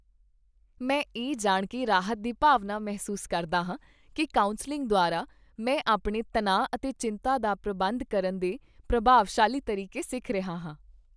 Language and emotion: Punjabi, happy